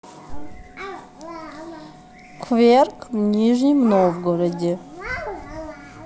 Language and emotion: Russian, neutral